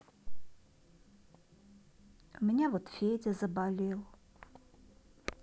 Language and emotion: Russian, sad